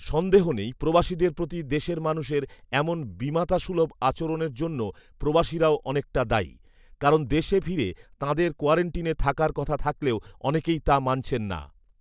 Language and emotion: Bengali, neutral